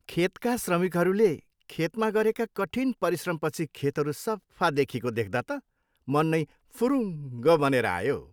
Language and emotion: Nepali, happy